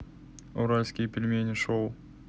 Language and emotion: Russian, neutral